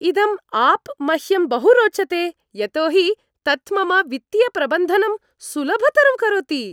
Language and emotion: Sanskrit, happy